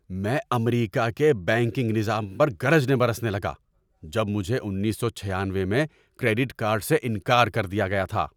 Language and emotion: Urdu, angry